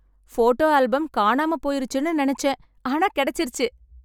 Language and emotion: Tamil, happy